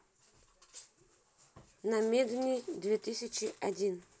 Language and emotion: Russian, neutral